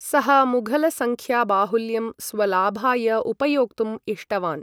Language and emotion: Sanskrit, neutral